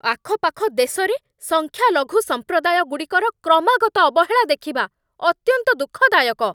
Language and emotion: Odia, angry